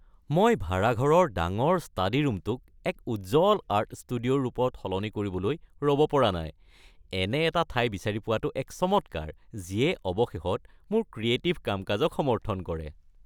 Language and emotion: Assamese, happy